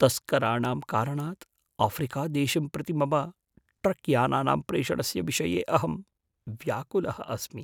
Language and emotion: Sanskrit, fearful